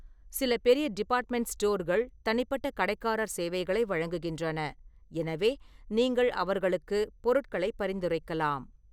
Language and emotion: Tamil, neutral